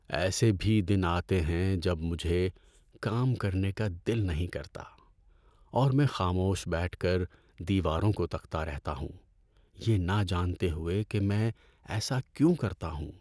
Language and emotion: Urdu, sad